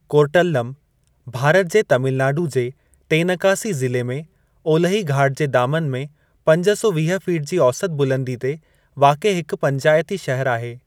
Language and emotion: Sindhi, neutral